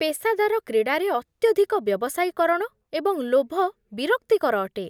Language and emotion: Odia, disgusted